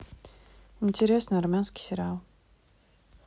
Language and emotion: Russian, neutral